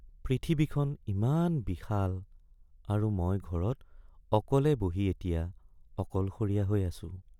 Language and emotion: Assamese, sad